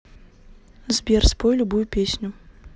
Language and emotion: Russian, neutral